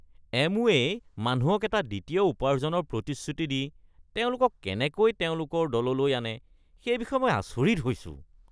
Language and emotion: Assamese, disgusted